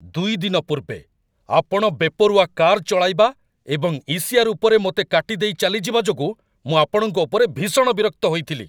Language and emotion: Odia, angry